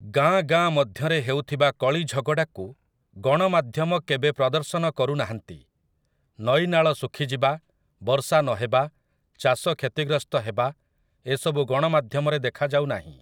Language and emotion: Odia, neutral